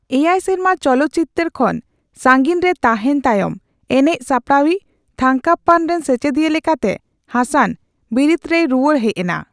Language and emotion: Santali, neutral